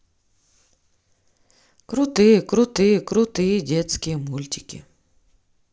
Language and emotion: Russian, neutral